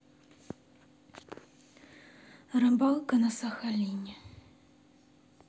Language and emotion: Russian, sad